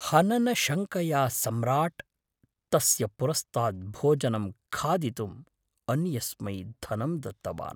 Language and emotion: Sanskrit, fearful